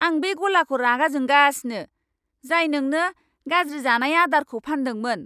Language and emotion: Bodo, angry